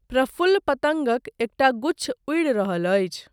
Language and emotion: Maithili, neutral